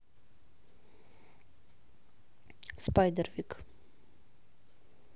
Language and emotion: Russian, neutral